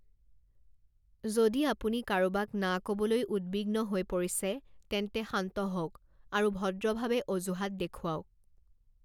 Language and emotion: Assamese, neutral